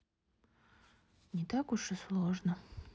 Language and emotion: Russian, sad